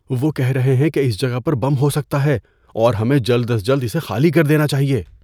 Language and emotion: Urdu, fearful